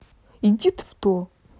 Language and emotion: Russian, angry